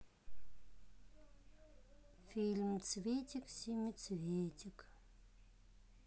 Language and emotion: Russian, sad